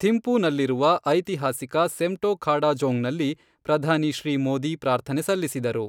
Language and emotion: Kannada, neutral